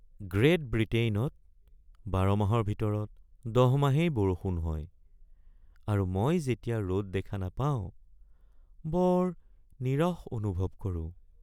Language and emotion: Assamese, sad